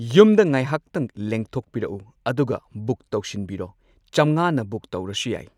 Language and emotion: Manipuri, neutral